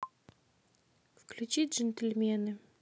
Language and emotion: Russian, neutral